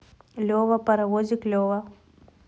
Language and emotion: Russian, neutral